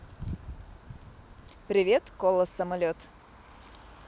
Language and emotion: Russian, positive